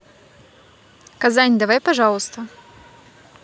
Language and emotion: Russian, neutral